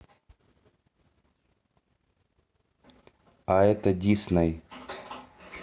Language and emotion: Russian, neutral